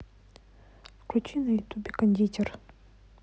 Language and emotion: Russian, neutral